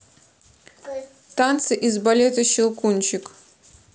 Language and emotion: Russian, neutral